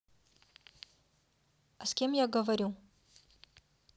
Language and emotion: Russian, neutral